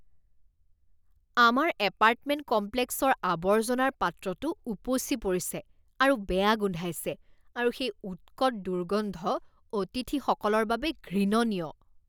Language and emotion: Assamese, disgusted